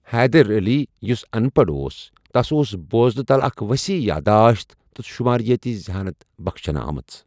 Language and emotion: Kashmiri, neutral